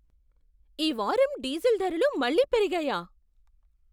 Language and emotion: Telugu, surprised